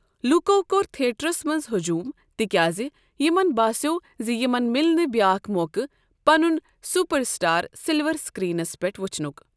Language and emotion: Kashmiri, neutral